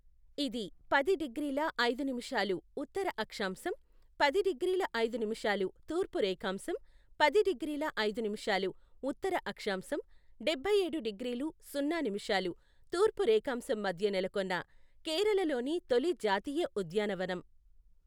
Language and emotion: Telugu, neutral